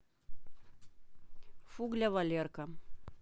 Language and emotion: Russian, neutral